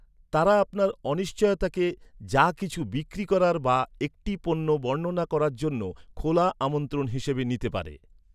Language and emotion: Bengali, neutral